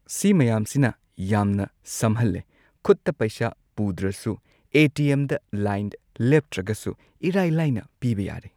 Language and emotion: Manipuri, neutral